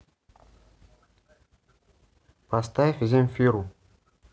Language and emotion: Russian, neutral